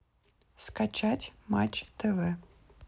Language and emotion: Russian, neutral